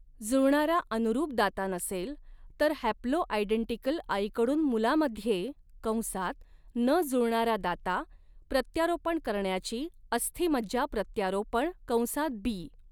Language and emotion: Marathi, neutral